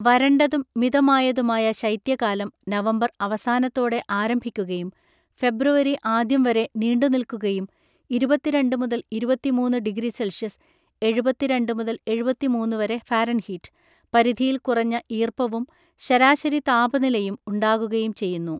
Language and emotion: Malayalam, neutral